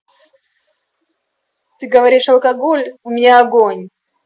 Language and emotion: Russian, angry